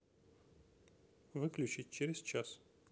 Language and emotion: Russian, neutral